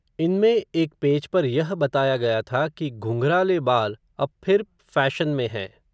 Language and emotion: Hindi, neutral